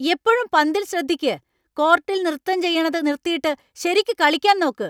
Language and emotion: Malayalam, angry